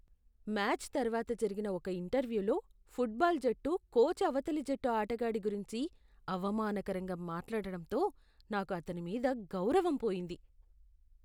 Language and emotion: Telugu, disgusted